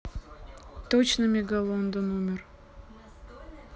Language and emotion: Russian, sad